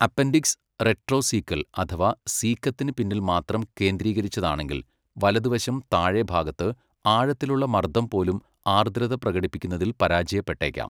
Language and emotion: Malayalam, neutral